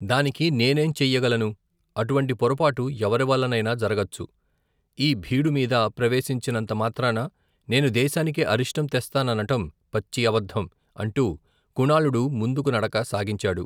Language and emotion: Telugu, neutral